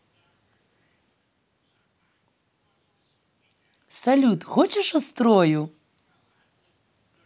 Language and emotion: Russian, positive